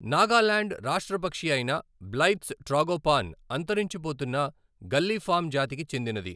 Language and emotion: Telugu, neutral